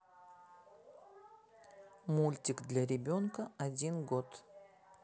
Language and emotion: Russian, neutral